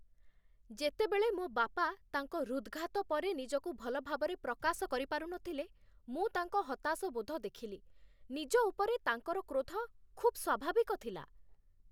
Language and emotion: Odia, angry